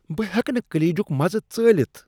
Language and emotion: Kashmiri, disgusted